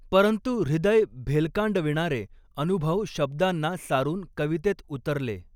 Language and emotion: Marathi, neutral